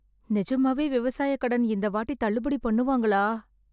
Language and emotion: Tamil, fearful